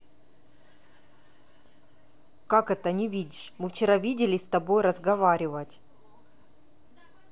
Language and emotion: Russian, angry